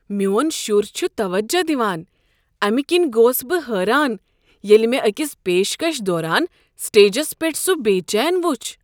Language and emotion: Kashmiri, surprised